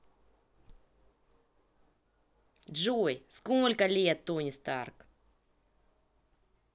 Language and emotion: Russian, neutral